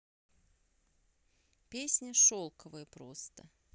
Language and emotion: Russian, neutral